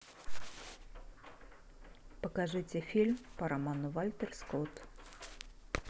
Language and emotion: Russian, neutral